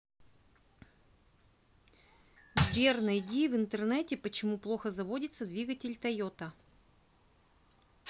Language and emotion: Russian, neutral